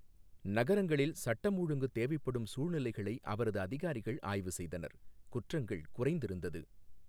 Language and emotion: Tamil, neutral